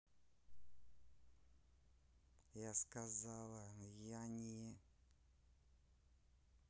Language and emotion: Russian, angry